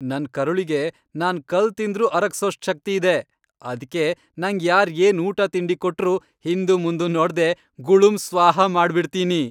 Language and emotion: Kannada, happy